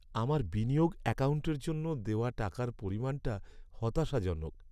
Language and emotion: Bengali, sad